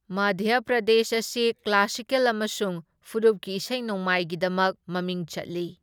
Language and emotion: Manipuri, neutral